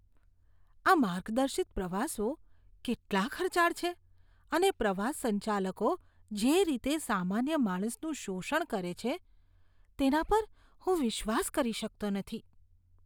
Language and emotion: Gujarati, disgusted